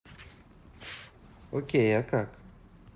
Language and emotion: Russian, neutral